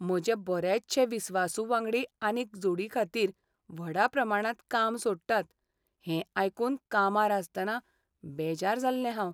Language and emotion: Goan Konkani, sad